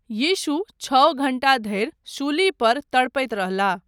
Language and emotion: Maithili, neutral